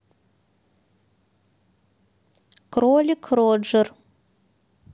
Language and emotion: Russian, neutral